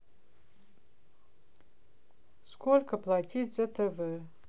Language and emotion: Russian, neutral